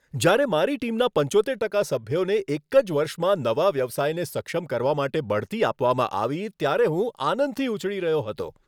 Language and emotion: Gujarati, happy